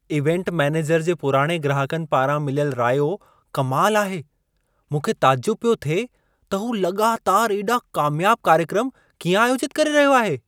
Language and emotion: Sindhi, surprised